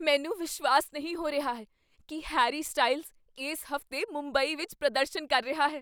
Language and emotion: Punjabi, surprised